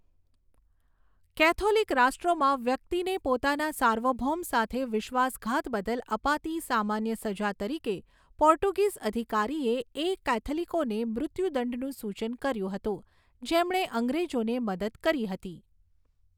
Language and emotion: Gujarati, neutral